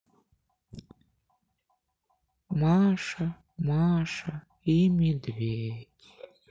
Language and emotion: Russian, sad